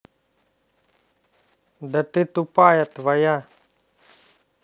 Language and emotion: Russian, angry